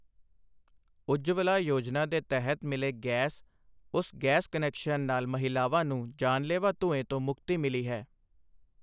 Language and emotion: Punjabi, neutral